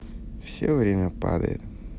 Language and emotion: Russian, neutral